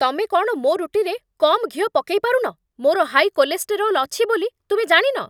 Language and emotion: Odia, angry